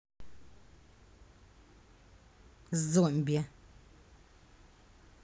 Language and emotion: Russian, angry